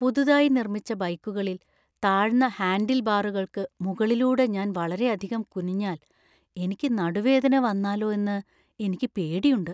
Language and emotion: Malayalam, fearful